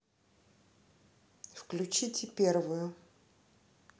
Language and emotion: Russian, neutral